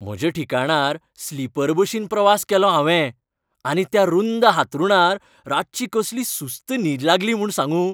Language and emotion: Goan Konkani, happy